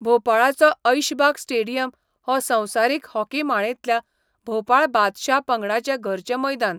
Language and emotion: Goan Konkani, neutral